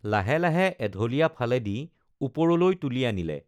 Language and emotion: Assamese, neutral